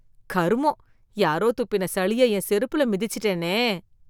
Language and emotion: Tamil, disgusted